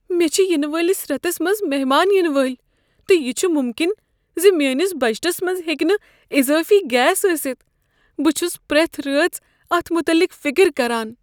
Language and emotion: Kashmiri, fearful